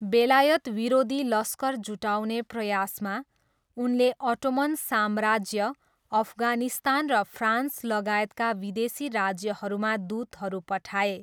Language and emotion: Nepali, neutral